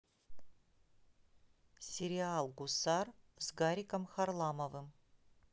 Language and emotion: Russian, neutral